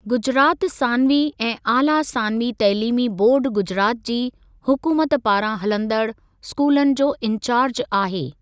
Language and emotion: Sindhi, neutral